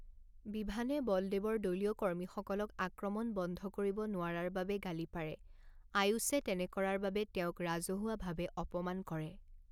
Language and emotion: Assamese, neutral